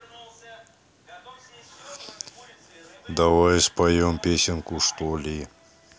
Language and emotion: Russian, neutral